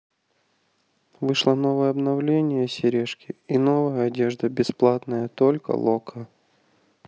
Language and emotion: Russian, neutral